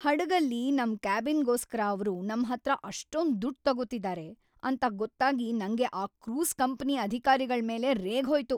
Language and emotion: Kannada, angry